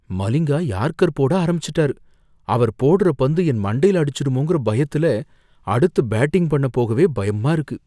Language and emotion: Tamil, fearful